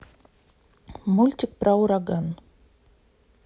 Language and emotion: Russian, neutral